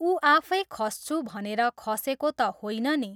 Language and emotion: Nepali, neutral